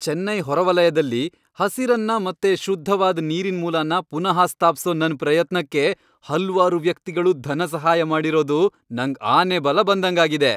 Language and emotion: Kannada, happy